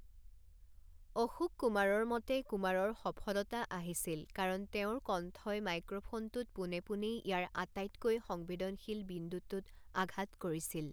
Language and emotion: Assamese, neutral